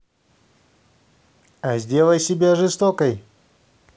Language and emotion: Russian, positive